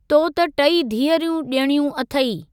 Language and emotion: Sindhi, neutral